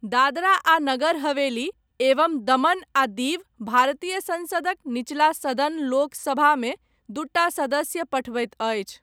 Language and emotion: Maithili, neutral